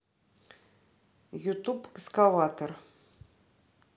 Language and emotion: Russian, neutral